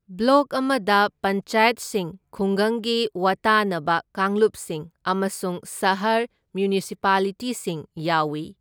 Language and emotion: Manipuri, neutral